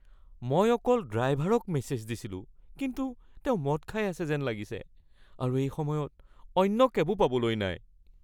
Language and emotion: Assamese, fearful